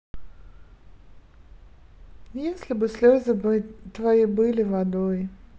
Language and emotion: Russian, sad